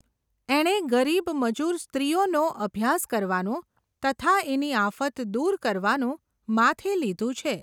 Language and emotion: Gujarati, neutral